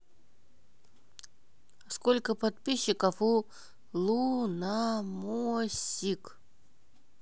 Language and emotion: Russian, neutral